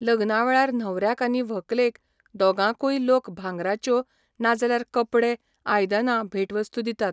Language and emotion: Goan Konkani, neutral